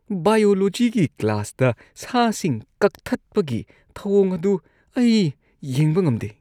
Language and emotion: Manipuri, disgusted